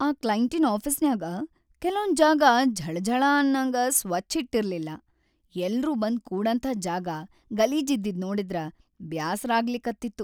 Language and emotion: Kannada, sad